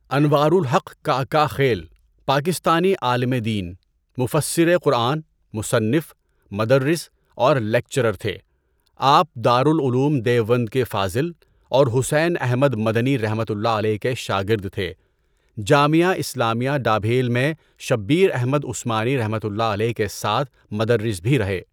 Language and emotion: Urdu, neutral